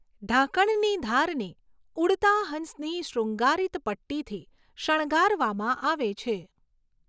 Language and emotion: Gujarati, neutral